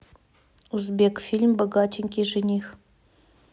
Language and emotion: Russian, neutral